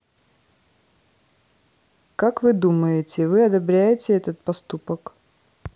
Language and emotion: Russian, neutral